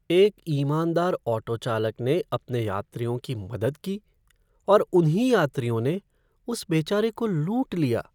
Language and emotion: Hindi, sad